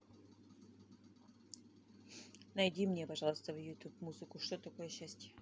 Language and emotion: Russian, neutral